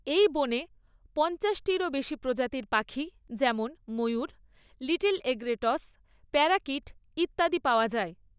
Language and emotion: Bengali, neutral